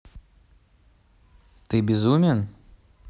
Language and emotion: Russian, neutral